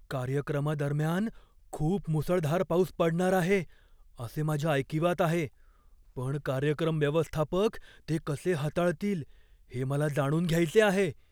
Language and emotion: Marathi, fearful